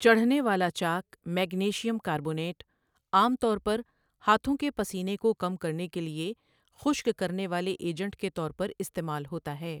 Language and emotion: Urdu, neutral